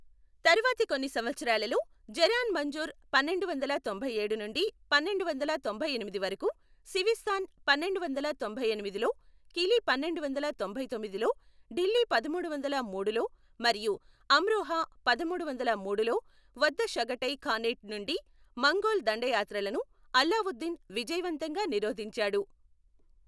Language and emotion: Telugu, neutral